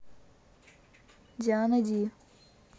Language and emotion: Russian, neutral